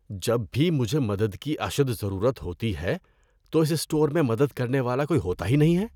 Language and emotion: Urdu, disgusted